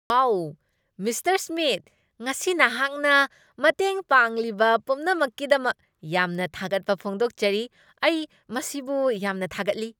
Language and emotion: Manipuri, happy